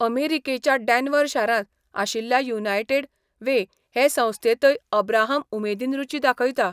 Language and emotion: Goan Konkani, neutral